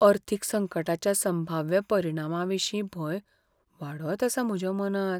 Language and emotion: Goan Konkani, fearful